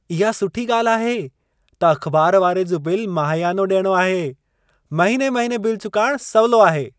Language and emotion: Sindhi, happy